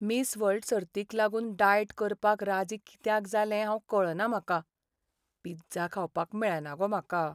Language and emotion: Goan Konkani, sad